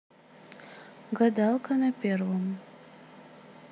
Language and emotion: Russian, neutral